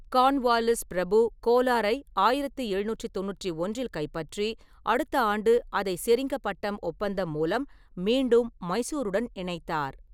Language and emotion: Tamil, neutral